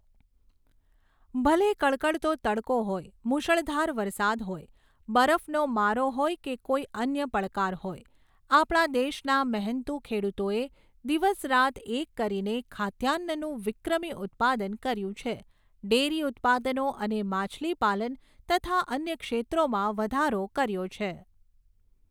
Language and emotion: Gujarati, neutral